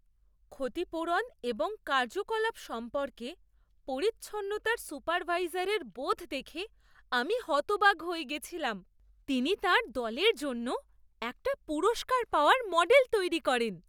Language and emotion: Bengali, surprised